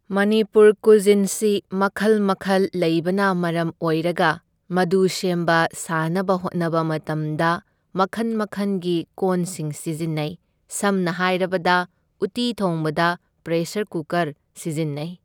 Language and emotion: Manipuri, neutral